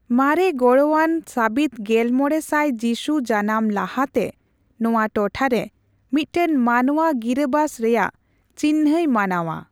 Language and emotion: Santali, neutral